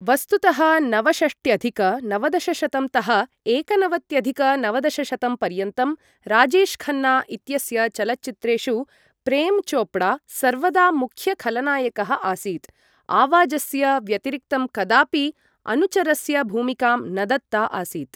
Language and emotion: Sanskrit, neutral